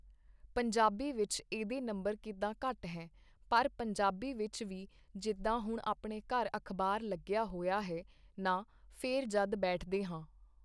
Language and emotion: Punjabi, neutral